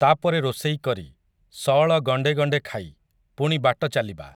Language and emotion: Odia, neutral